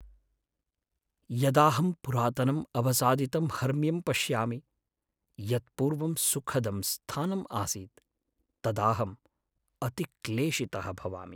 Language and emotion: Sanskrit, sad